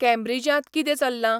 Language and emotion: Goan Konkani, neutral